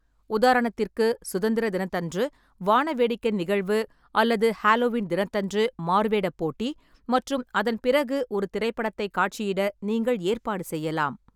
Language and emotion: Tamil, neutral